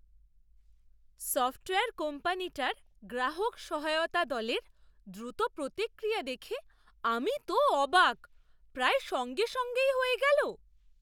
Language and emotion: Bengali, surprised